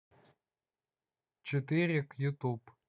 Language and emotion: Russian, neutral